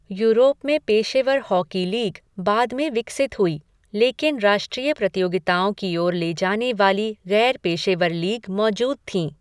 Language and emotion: Hindi, neutral